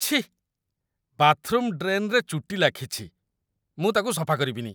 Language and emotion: Odia, disgusted